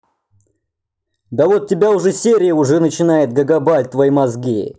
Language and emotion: Russian, angry